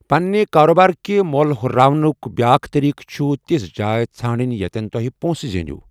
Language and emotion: Kashmiri, neutral